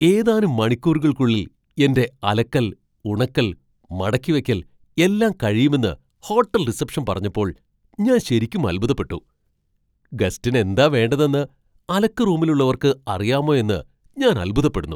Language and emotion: Malayalam, surprised